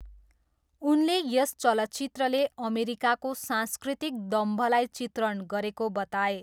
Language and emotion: Nepali, neutral